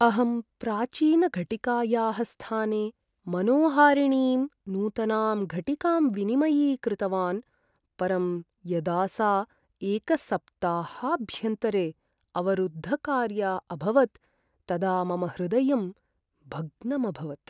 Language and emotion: Sanskrit, sad